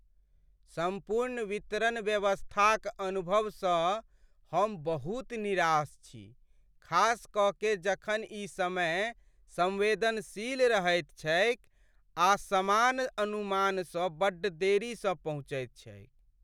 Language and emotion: Maithili, sad